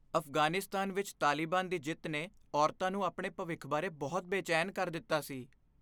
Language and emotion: Punjabi, fearful